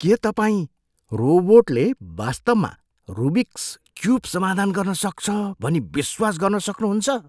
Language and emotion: Nepali, surprised